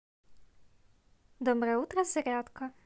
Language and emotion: Russian, positive